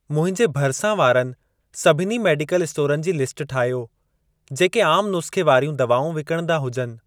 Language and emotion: Sindhi, neutral